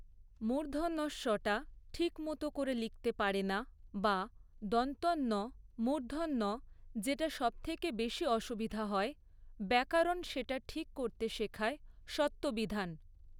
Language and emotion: Bengali, neutral